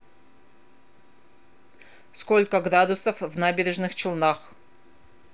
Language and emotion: Russian, neutral